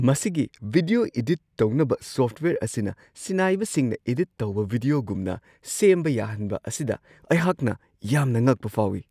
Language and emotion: Manipuri, surprised